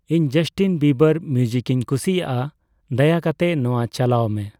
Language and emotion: Santali, neutral